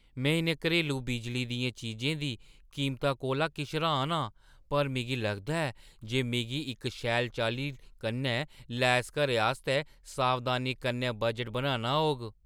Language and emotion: Dogri, surprised